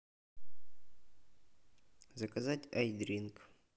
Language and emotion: Russian, neutral